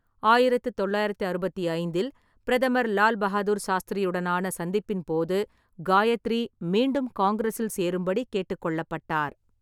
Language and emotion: Tamil, neutral